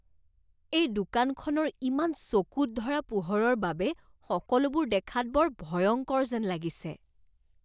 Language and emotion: Assamese, disgusted